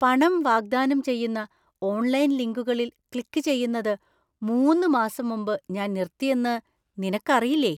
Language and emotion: Malayalam, surprised